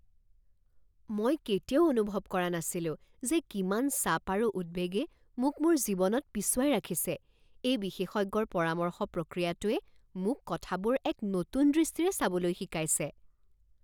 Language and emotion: Assamese, surprised